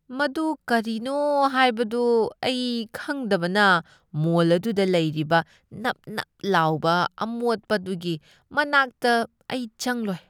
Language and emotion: Manipuri, disgusted